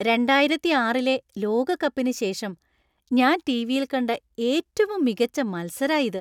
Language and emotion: Malayalam, happy